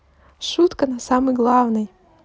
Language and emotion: Russian, neutral